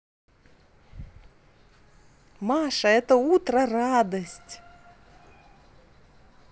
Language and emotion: Russian, positive